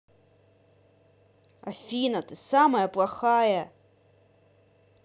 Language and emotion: Russian, angry